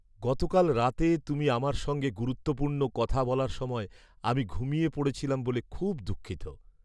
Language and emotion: Bengali, sad